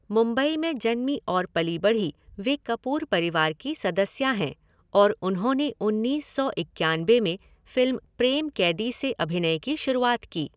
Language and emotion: Hindi, neutral